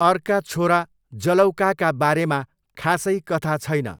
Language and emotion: Nepali, neutral